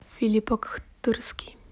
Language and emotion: Russian, neutral